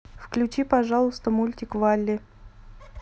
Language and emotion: Russian, neutral